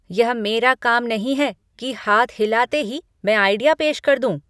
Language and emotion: Hindi, angry